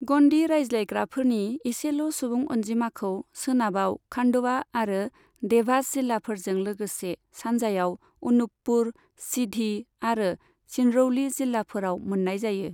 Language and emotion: Bodo, neutral